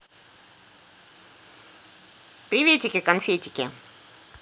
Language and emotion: Russian, positive